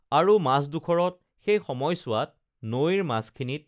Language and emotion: Assamese, neutral